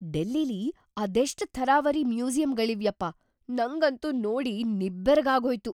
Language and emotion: Kannada, surprised